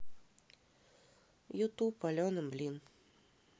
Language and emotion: Russian, neutral